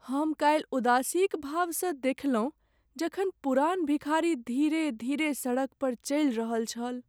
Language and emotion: Maithili, sad